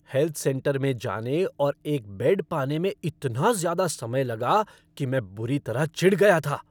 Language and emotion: Hindi, angry